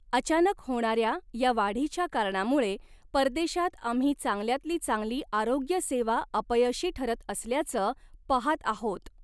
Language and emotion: Marathi, neutral